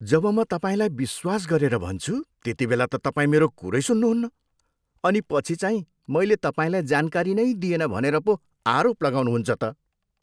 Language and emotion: Nepali, disgusted